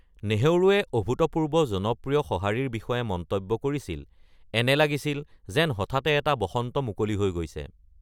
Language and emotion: Assamese, neutral